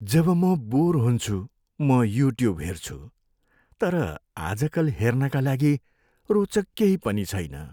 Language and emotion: Nepali, sad